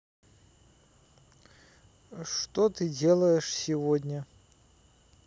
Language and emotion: Russian, neutral